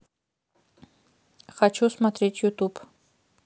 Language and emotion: Russian, neutral